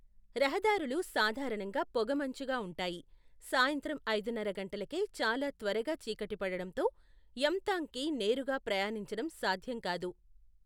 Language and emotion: Telugu, neutral